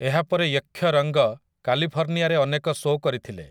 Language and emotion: Odia, neutral